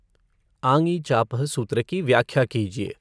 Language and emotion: Hindi, neutral